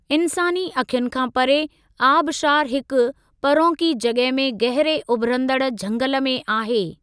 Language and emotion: Sindhi, neutral